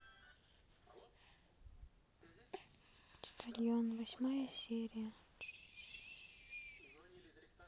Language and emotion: Russian, sad